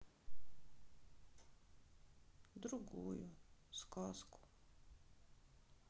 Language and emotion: Russian, sad